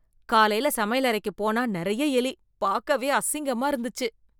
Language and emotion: Tamil, disgusted